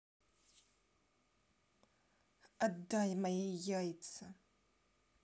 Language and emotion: Russian, angry